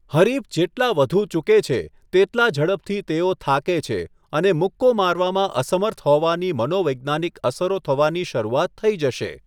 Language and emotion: Gujarati, neutral